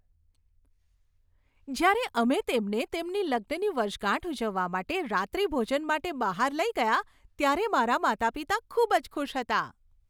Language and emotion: Gujarati, happy